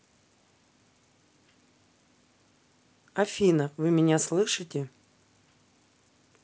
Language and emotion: Russian, neutral